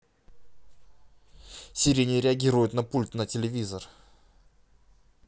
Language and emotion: Russian, angry